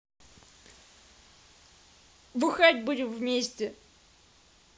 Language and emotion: Russian, positive